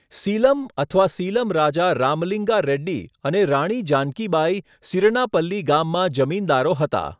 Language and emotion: Gujarati, neutral